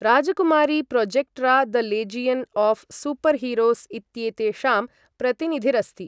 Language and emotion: Sanskrit, neutral